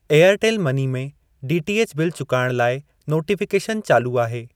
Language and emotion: Sindhi, neutral